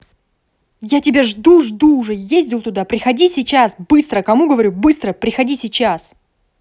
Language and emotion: Russian, angry